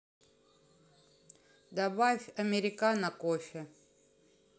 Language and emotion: Russian, neutral